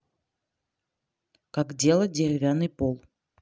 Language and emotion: Russian, neutral